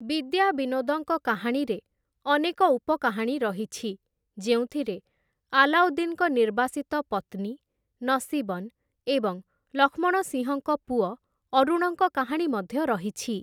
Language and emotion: Odia, neutral